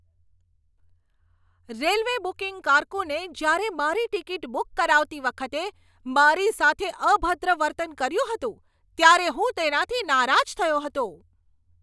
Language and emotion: Gujarati, angry